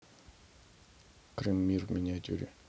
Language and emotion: Russian, neutral